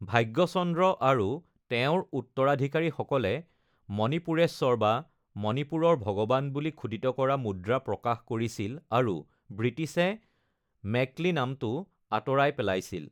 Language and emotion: Assamese, neutral